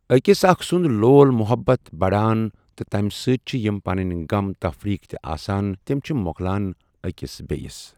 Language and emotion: Kashmiri, neutral